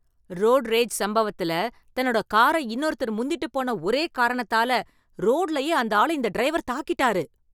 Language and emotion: Tamil, angry